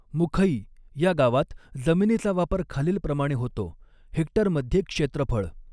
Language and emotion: Marathi, neutral